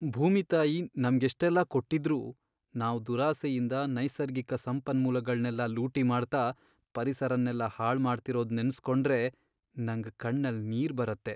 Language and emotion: Kannada, sad